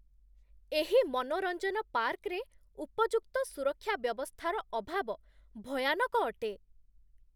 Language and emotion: Odia, disgusted